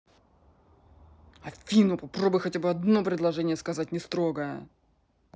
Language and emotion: Russian, angry